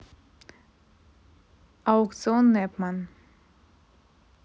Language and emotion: Russian, neutral